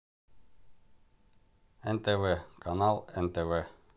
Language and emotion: Russian, neutral